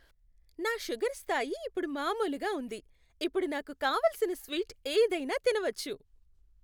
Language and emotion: Telugu, happy